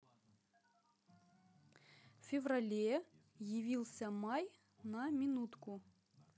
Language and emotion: Russian, neutral